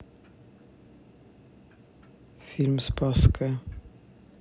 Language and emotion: Russian, neutral